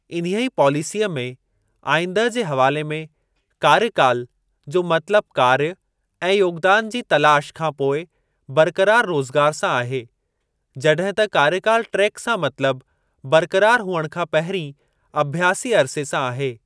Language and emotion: Sindhi, neutral